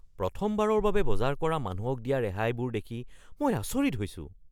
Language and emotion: Assamese, surprised